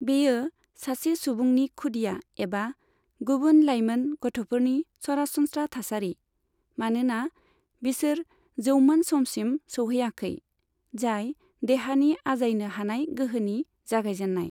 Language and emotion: Bodo, neutral